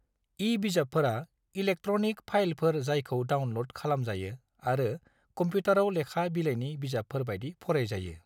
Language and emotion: Bodo, neutral